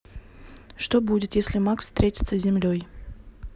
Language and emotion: Russian, neutral